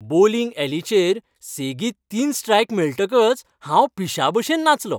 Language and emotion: Goan Konkani, happy